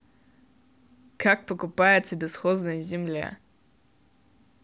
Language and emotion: Russian, neutral